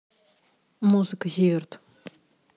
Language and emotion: Russian, neutral